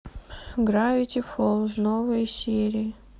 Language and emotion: Russian, sad